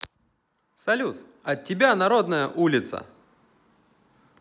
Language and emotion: Russian, positive